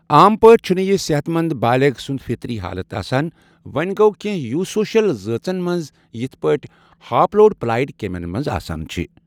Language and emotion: Kashmiri, neutral